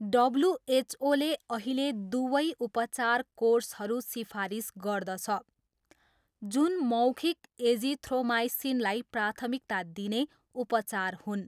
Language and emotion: Nepali, neutral